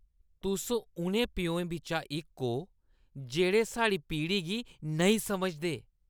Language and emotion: Dogri, disgusted